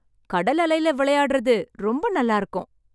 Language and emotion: Tamil, happy